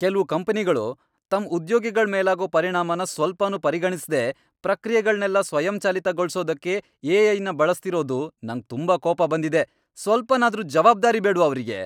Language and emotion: Kannada, angry